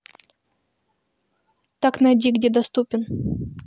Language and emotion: Russian, neutral